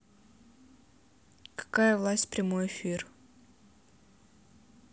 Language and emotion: Russian, neutral